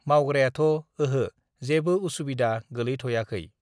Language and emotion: Bodo, neutral